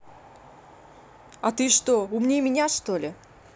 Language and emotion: Russian, angry